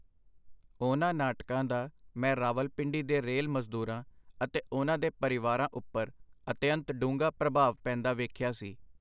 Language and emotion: Punjabi, neutral